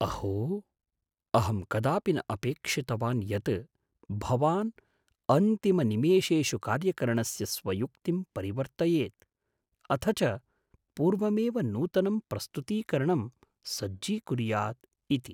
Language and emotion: Sanskrit, surprised